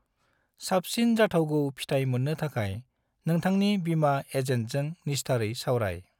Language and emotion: Bodo, neutral